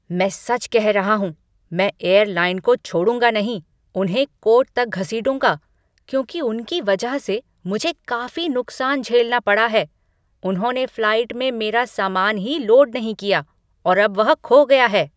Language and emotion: Hindi, angry